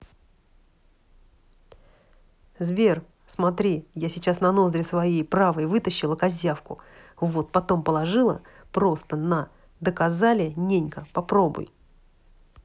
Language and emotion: Russian, angry